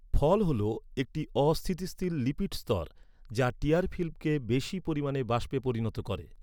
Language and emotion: Bengali, neutral